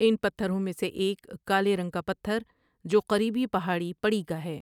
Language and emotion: Urdu, neutral